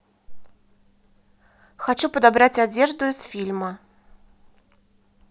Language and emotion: Russian, neutral